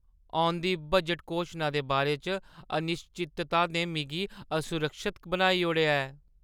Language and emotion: Dogri, fearful